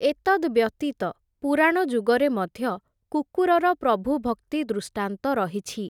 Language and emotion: Odia, neutral